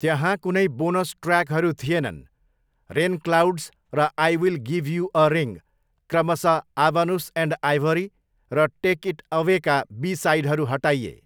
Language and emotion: Nepali, neutral